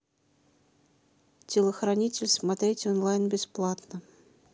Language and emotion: Russian, neutral